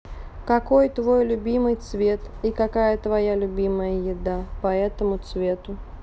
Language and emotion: Russian, neutral